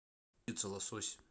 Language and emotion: Russian, neutral